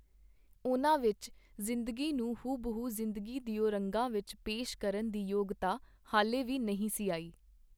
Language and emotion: Punjabi, neutral